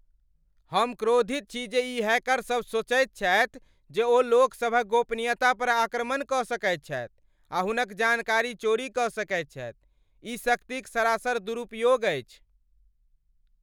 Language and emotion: Maithili, angry